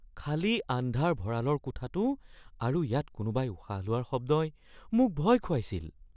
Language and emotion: Assamese, fearful